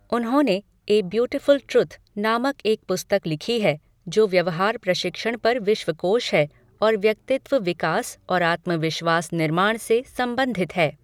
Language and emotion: Hindi, neutral